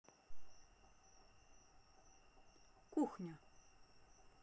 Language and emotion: Russian, neutral